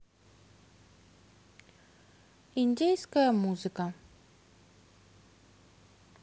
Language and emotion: Russian, neutral